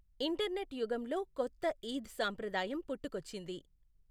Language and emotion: Telugu, neutral